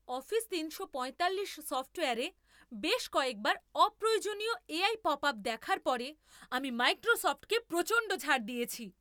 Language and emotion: Bengali, angry